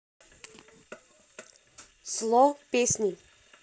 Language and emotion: Russian, neutral